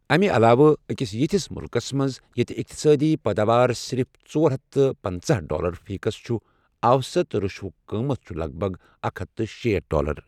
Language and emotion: Kashmiri, neutral